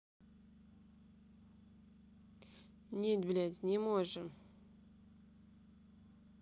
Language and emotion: Russian, angry